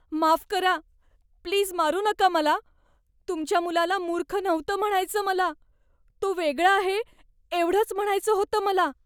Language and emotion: Marathi, fearful